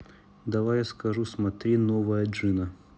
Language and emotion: Russian, neutral